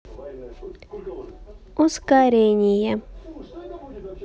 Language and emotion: Russian, neutral